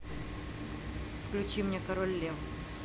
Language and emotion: Russian, neutral